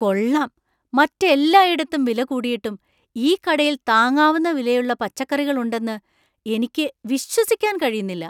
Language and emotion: Malayalam, surprised